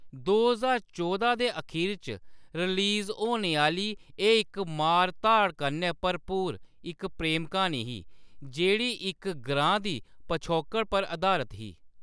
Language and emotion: Dogri, neutral